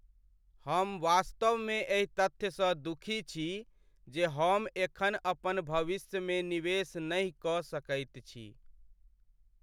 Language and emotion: Maithili, sad